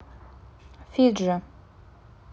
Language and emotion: Russian, neutral